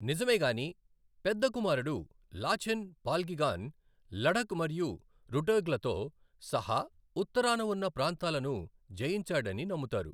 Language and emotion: Telugu, neutral